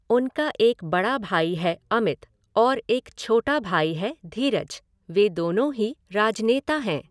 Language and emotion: Hindi, neutral